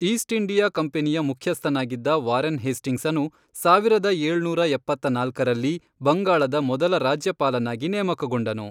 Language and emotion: Kannada, neutral